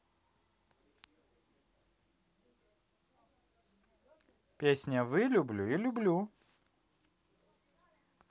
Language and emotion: Russian, positive